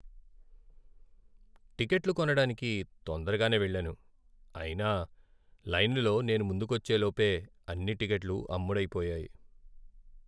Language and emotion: Telugu, sad